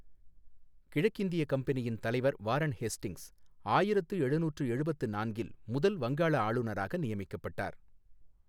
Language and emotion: Tamil, neutral